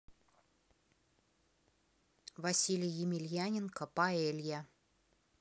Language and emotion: Russian, neutral